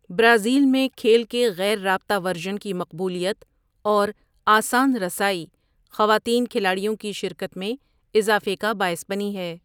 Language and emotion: Urdu, neutral